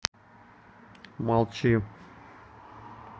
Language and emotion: Russian, neutral